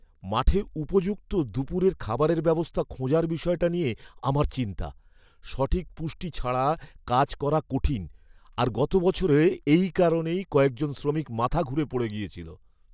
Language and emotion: Bengali, fearful